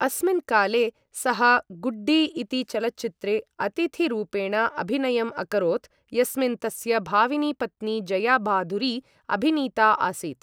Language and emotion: Sanskrit, neutral